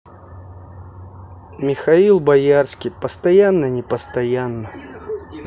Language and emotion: Russian, neutral